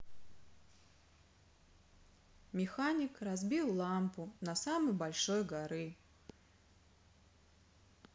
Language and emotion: Russian, sad